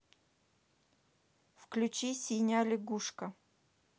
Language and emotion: Russian, neutral